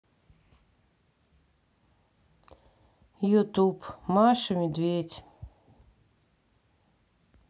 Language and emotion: Russian, sad